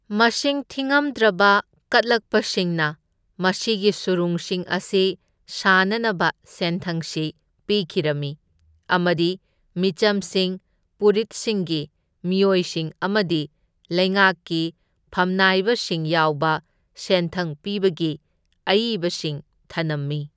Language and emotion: Manipuri, neutral